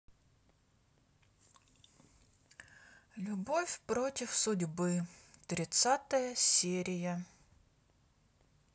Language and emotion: Russian, sad